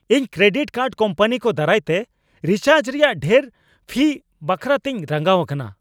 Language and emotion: Santali, angry